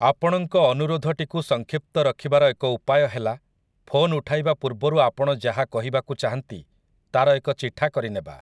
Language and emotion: Odia, neutral